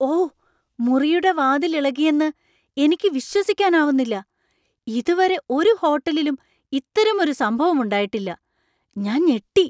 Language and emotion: Malayalam, surprised